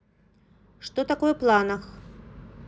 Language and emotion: Russian, neutral